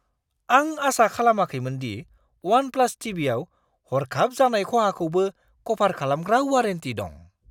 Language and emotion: Bodo, surprised